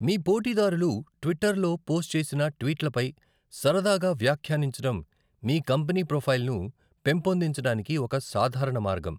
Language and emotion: Telugu, neutral